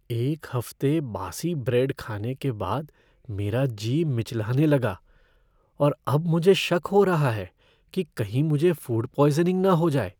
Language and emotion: Hindi, fearful